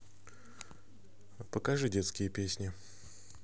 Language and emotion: Russian, neutral